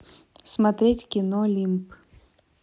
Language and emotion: Russian, neutral